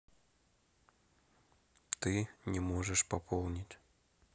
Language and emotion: Russian, neutral